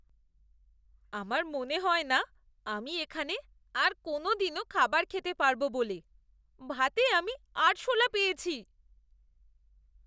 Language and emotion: Bengali, disgusted